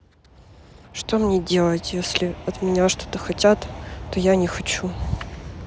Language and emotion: Russian, sad